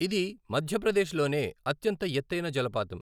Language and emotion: Telugu, neutral